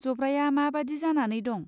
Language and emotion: Bodo, neutral